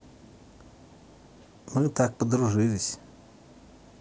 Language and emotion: Russian, neutral